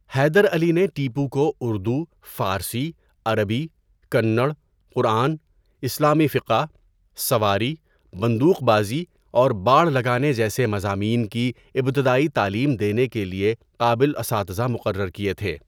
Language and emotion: Urdu, neutral